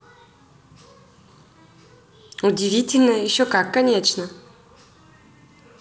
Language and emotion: Russian, positive